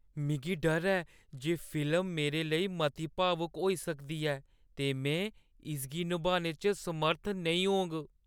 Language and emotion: Dogri, fearful